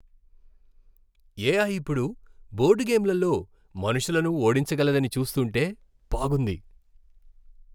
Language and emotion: Telugu, happy